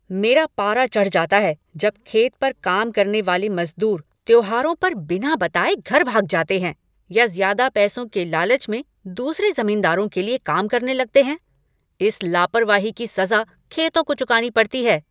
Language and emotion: Hindi, angry